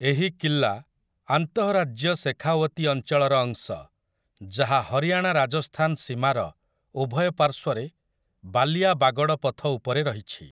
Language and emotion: Odia, neutral